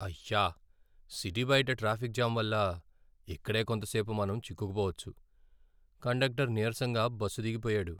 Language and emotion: Telugu, sad